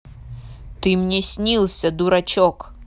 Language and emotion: Russian, angry